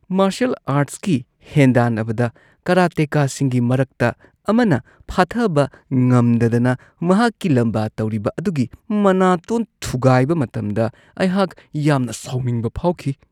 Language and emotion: Manipuri, disgusted